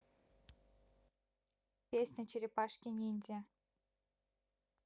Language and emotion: Russian, neutral